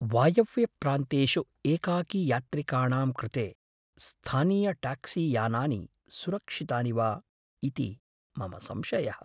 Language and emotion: Sanskrit, fearful